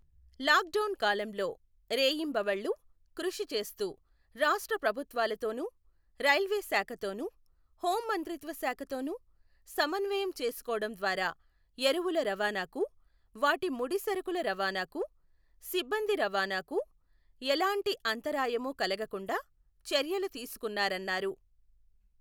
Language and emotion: Telugu, neutral